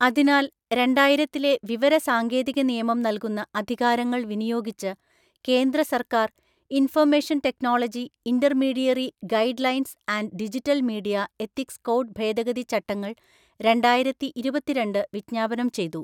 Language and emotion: Malayalam, neutral